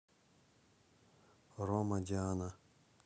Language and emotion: Russian, neutral